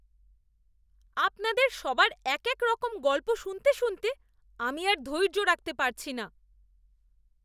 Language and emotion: Bengali, disgusted